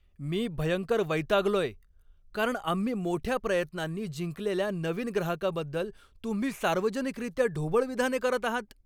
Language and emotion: Marathi, angry